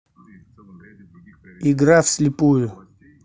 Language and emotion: Russian, neutral